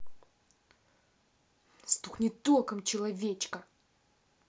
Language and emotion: Russian, angry